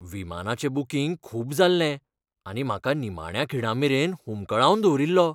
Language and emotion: Goan Konkani, fearful